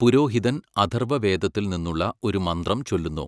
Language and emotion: Malayalam, neutral